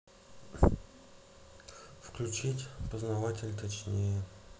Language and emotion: Russian, neutral